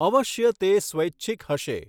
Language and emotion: Gujarati, neutral